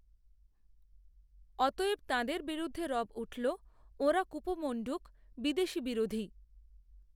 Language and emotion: Bengali, neutral